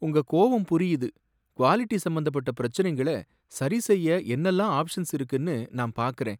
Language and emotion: Tamil, sad